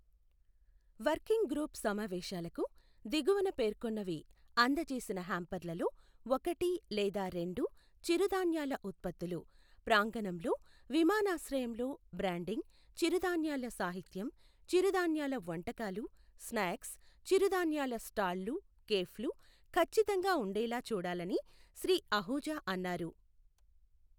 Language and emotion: Telugu, neutral